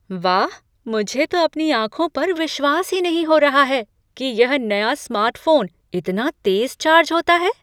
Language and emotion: Hindi, surprised